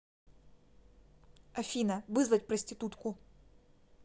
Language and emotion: Russian, neutral